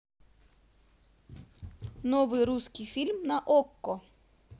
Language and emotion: Russian, positive